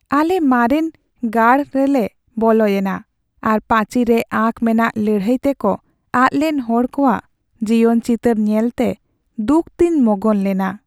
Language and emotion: Santali, sad